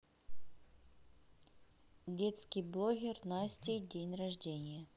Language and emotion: Russian, neutral